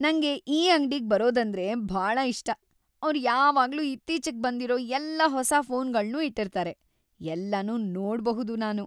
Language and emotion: Kannada, happy